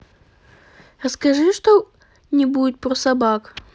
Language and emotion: Russian, neutral